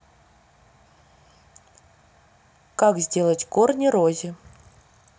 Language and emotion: Russian, neutral